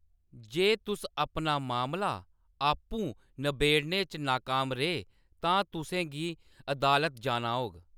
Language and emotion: Dogri, neutral